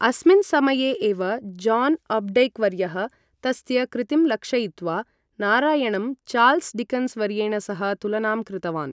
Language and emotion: Sanskrit, neutral